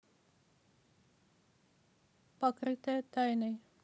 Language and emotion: Russian, neutral